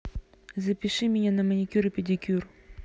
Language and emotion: Russian, neutral